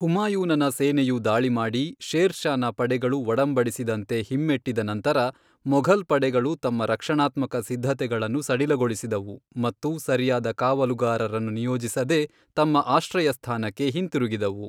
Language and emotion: Kannada, neutral